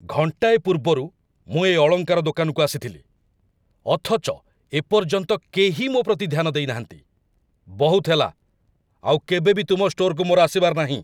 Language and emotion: Odia, angry